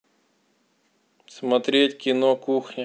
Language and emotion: Russian, neutral